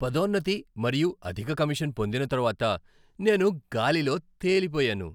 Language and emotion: Telugu, happy